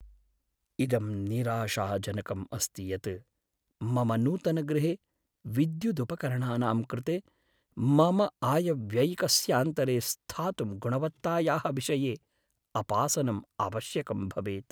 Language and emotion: Sanskrit, sad